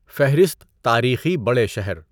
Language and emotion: Urdu, neutral